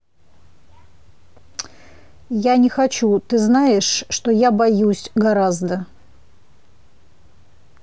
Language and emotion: Russian, neutral